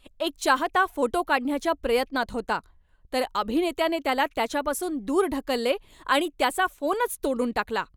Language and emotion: Marathi, angry